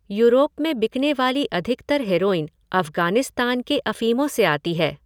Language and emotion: Hindi, neutral